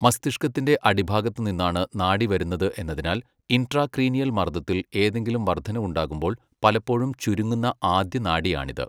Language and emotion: Malayalam, neutral